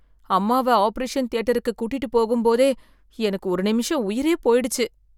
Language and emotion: Tamil, fearful